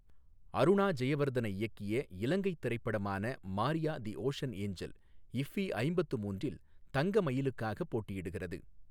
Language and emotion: Tamil, neutral